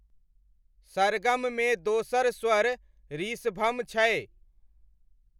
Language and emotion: Maithili, neutral